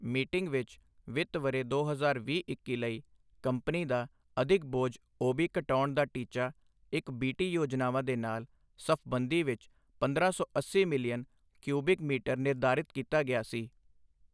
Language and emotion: Punjabi, neutral